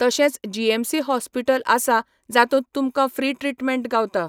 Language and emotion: Goan Konkani, neutral